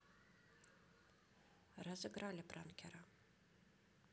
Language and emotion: Russian, neutral